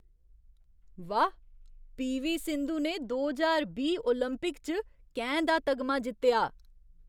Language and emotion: Dogri, surprised